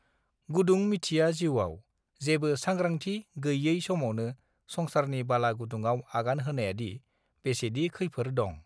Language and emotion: Bodo, neutral